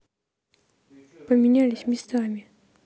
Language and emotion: Russian, neutral